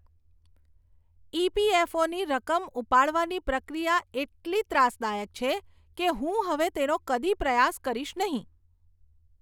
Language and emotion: Gujarati, disgusted